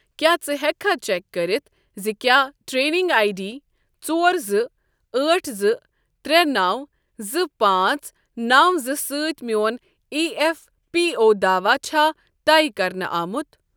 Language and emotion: Kashmiri, neutral